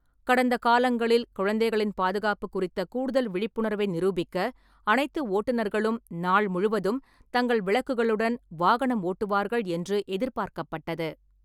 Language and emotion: Tamil, neutral